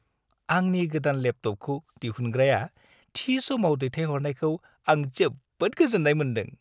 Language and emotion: Bodo, happy